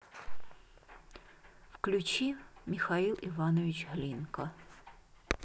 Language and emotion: Russian, neutral